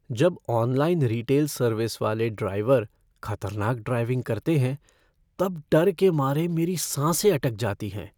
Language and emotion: Hindi, fearful